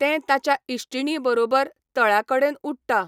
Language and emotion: Goan Konkani, neutral